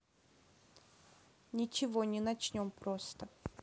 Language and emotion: Russian, neutral